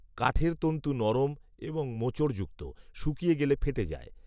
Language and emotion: Bengali, neutral